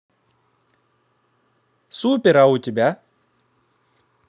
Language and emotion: Russian, positive